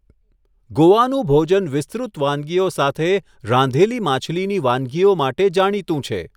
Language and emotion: Gujarati, neutral